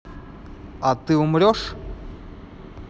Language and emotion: Russian, neutral